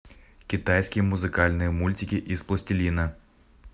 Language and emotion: Russian, neutral